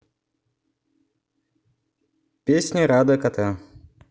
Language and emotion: Russian, neutral